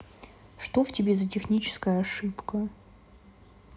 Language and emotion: Russian, neutral